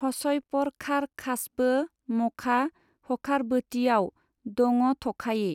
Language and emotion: Bodo, neutral